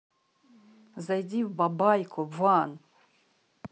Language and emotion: Russian, angry